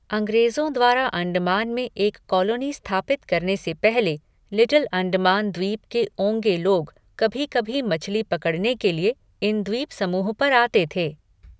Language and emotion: Hindi, neutral